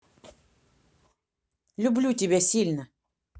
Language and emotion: Russian, neutral